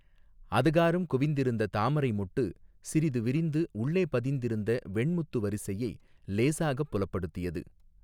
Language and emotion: Tamil, neutral